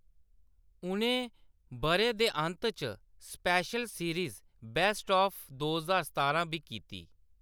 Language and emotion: Dogri, neutral